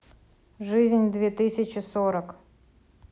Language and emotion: Russian, neutral